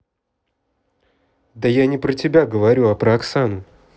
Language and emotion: Russian, neutral